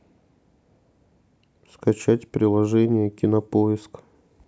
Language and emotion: Russian, neutral